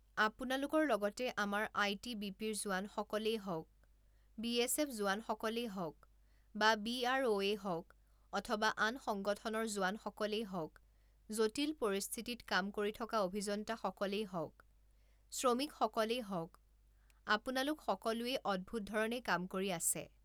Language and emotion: Assamese, neutral